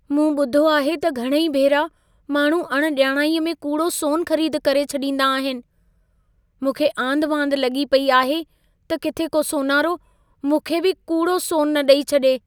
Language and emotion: Sindhi, fearful